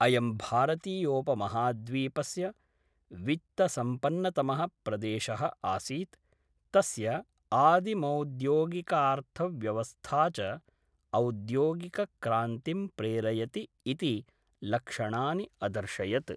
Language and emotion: Sanskrit, neutral